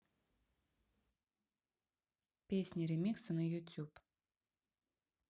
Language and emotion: Russian, neutral